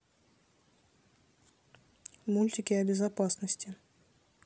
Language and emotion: Russian, neutral